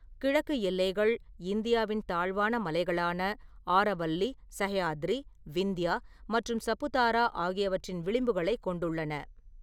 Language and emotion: Tamil, neutral